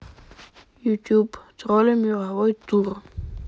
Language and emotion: Russian, neutral